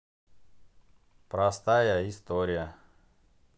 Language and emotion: Russian, neutral